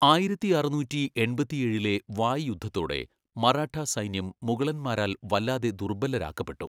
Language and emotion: Malayalam, neutral